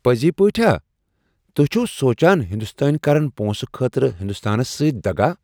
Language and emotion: Kashmiri, surprised